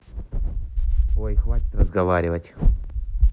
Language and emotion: Russian, neutral